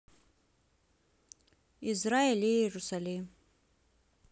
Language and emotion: Russian, neutral